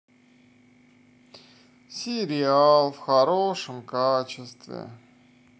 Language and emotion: Russian, sad